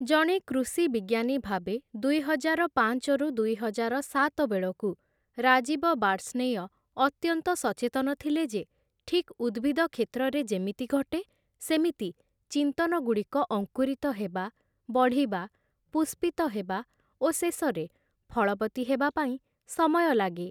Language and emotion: Odia, neutral